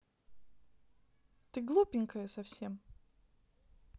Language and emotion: Russian, neutral